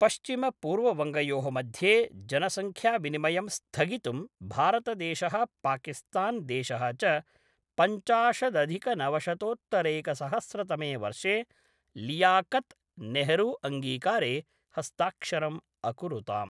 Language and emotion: Sanskrit, neutral